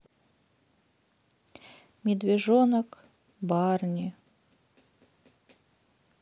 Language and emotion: Russian, sad